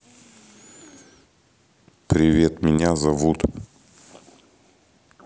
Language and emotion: Russian, neutral